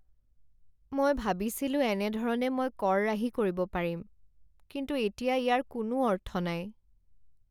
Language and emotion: Assamese, sad